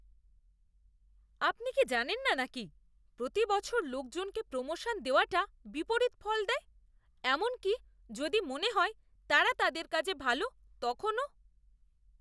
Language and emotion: Bengali, disgusted